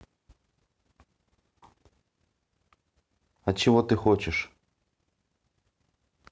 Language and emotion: Russian, neutral